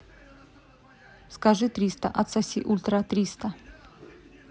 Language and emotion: Russian, neutral